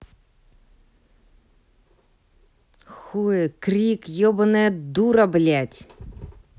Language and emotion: Russian, angry